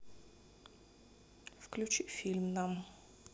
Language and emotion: Russian, neutral